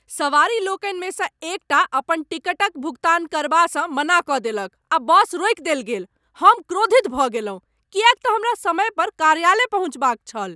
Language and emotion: Maithili, angry